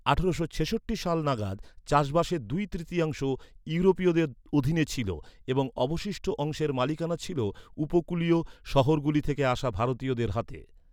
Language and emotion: Bengali, neutral